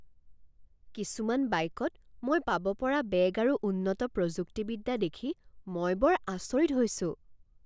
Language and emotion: Assamese, surprised